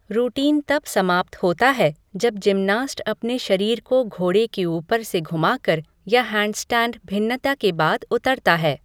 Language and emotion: Hindi, neutral